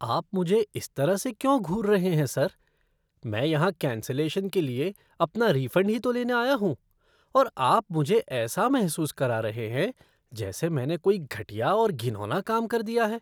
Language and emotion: Hindi, disgusted